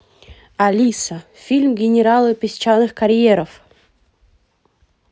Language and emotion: Russian, positive